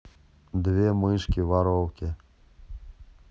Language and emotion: Russian, neutral